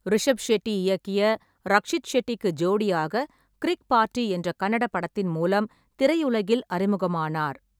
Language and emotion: Tamil, neutral